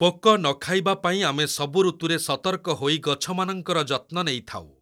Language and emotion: Odia, neutral